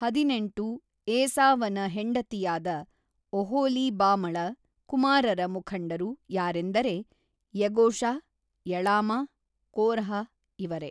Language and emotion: Kannada, neutral